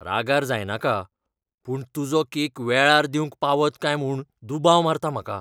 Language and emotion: Goan Konkani, fearful